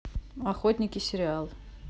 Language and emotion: Russian, neutral